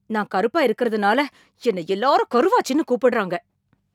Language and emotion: Tamil, angry